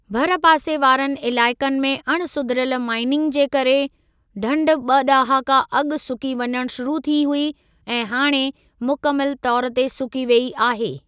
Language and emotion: Sindhi, neutral